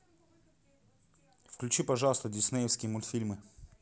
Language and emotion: Russian, neutral